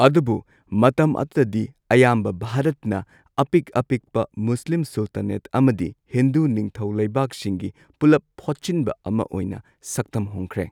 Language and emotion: Manipuri, neutral